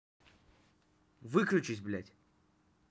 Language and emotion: Russian, angry